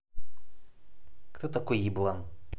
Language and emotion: Russian, angry